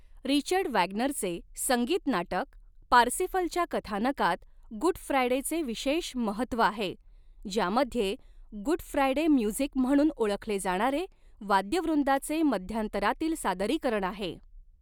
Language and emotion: Marathi, neutral